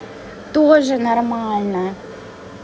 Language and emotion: Russian, neutral